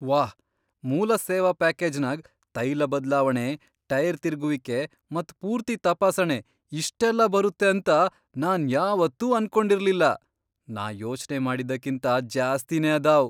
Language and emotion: Kannada, surprised